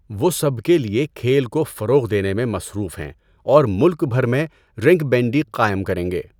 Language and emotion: Urdu, neutral